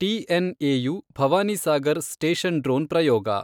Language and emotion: Kannada, neutral